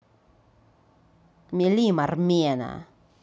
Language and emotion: Russian, angry